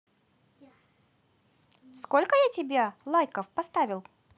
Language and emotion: Russian, positive